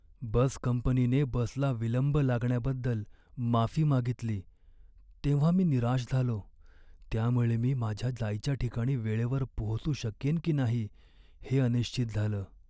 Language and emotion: Marathi, sad